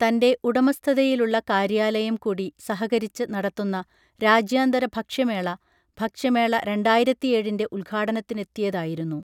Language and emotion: Malayalam, neutral